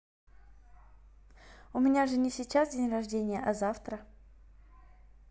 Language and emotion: Russian, neutral